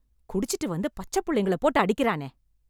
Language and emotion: Tamil, angry